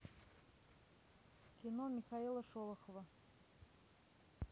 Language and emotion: Russian, neutral